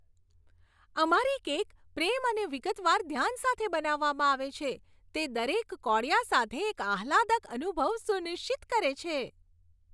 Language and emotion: Gujarati, happy